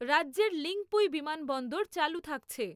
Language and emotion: Bengali, neutral